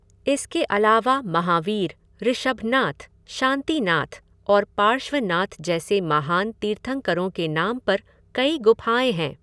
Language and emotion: Hindi, neutral